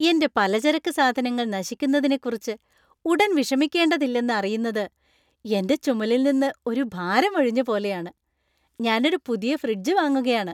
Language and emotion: Malayalam, happy